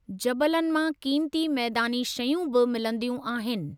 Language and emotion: Sindhi, neutral